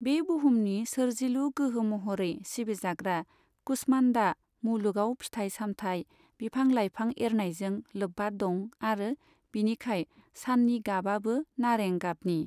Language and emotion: Bodo, neutral